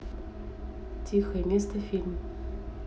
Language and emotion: Russian, neutral